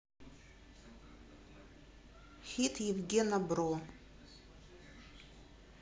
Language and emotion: Russian, neutral